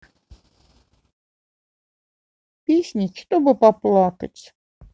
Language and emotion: Russian, sad